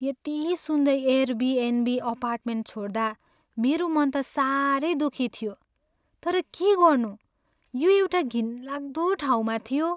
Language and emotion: Nepali, sad